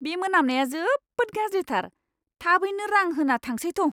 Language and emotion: Bodo, disgusted